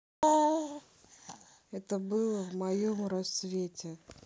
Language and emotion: Russian, neutral